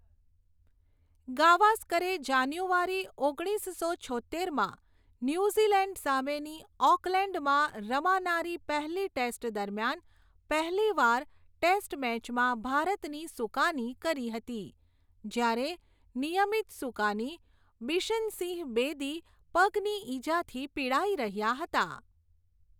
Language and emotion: Gujarati, neutral